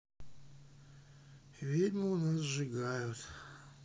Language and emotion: Russian, sad